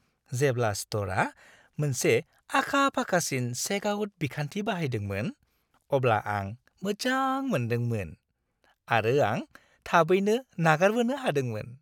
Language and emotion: Bodo, happy